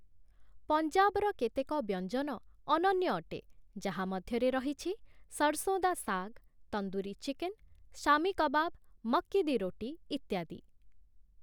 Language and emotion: Odia, neutral